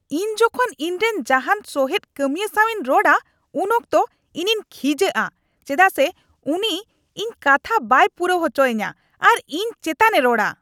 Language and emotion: Santali, angry